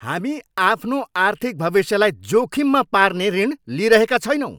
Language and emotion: Nepali, angry